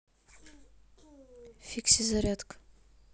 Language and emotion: Russian, neutral